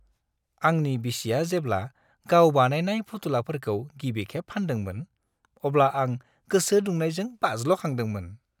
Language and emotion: Bodo, happy